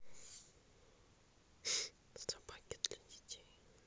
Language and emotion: Russian, neutral